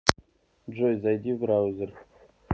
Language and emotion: Russian, neutral